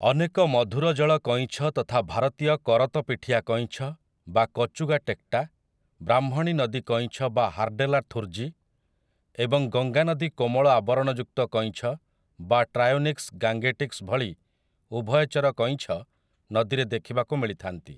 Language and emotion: Odia, neutral